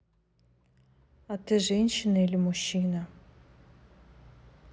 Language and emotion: Russian, neutral